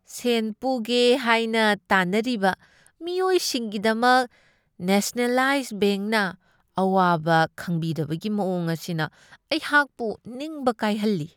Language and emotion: Manipuri, disgusted